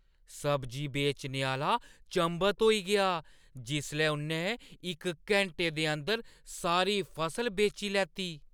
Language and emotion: Dogri, surprised